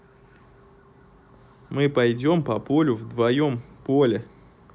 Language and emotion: Russian, neutral